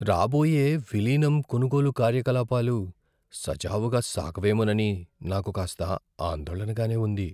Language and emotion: Telugu, fearful